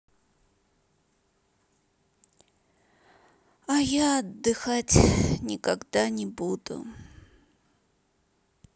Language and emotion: Russian, sad